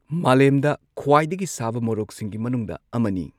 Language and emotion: Manipuri, neutral